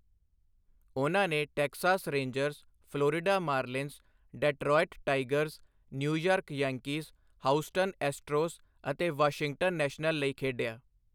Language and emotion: Punjabi, neutral